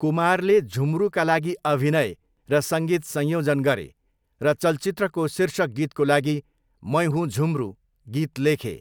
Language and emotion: Nepali, neutral